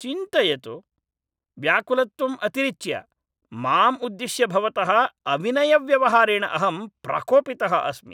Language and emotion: Sanskrit, angry